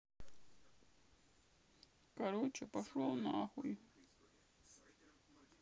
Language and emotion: Russian, sad